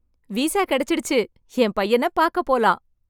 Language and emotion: Tamil, happy